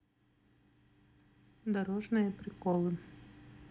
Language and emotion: Russian, neutral